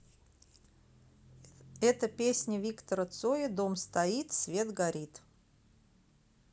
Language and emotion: Russian, neutral